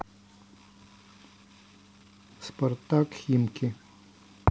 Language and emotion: Russian, neutral